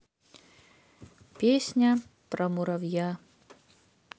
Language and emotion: Russian, neutral